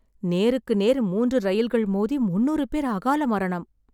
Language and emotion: Tamil, sad